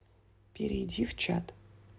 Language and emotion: Russian, neutral